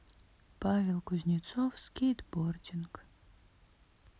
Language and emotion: Russian, sad